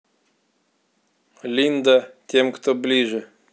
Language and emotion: Russian, neutral